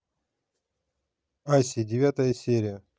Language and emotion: Russian, neutral